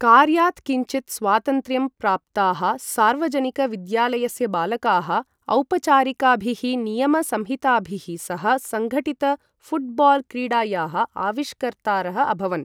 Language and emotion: Sanskrit, neutral